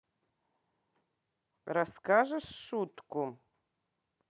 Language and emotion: Russian, neutral